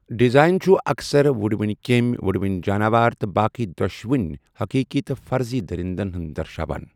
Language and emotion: Kashmiri, neutral